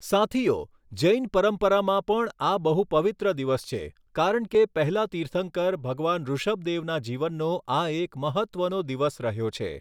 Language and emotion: Gujarati, neutral